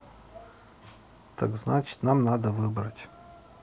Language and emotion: Russian, neutral